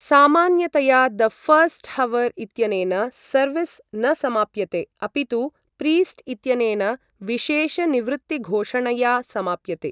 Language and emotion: Sanskrit, neutral